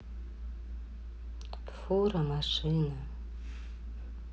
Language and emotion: Russian, sad